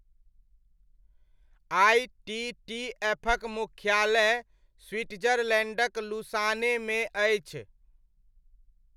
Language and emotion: Maithili, neutral